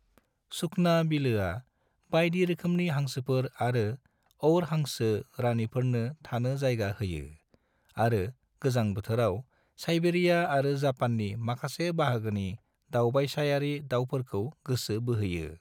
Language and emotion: Bodo, neutral